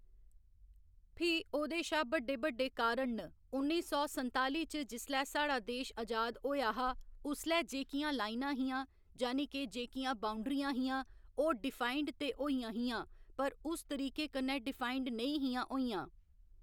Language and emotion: Dogri, neutral